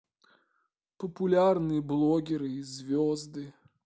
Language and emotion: Russian, sad